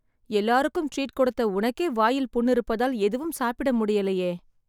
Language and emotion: Tamil, sad